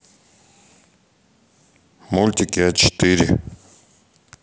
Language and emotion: Russian, neutral